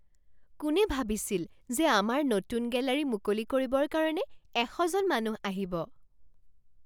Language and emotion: Assamese, surprised